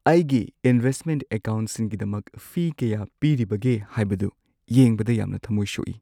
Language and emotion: Manipuri, sad